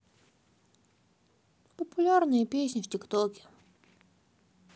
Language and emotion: Russian, sad